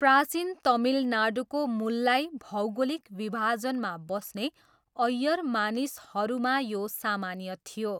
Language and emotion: Nepali, neutral